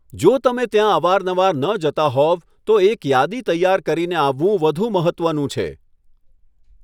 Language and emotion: Gujarati, neutral